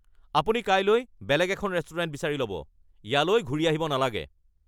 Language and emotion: Assamese, angry